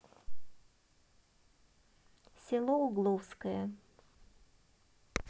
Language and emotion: Russian, neutral